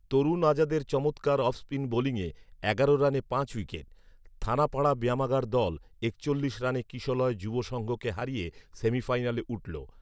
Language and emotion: Bengali, neutral